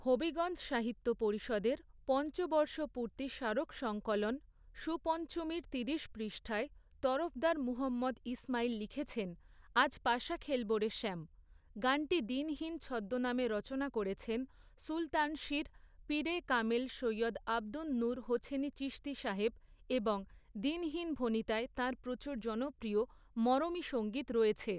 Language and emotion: Bengali, neutral